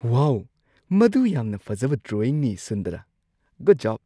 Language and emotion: Manipuri, surprised